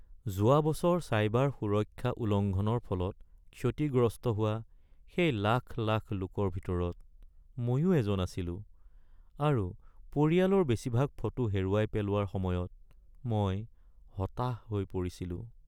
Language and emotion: Assamese, sad